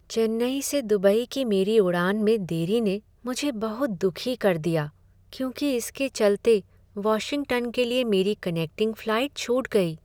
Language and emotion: Hindi, sad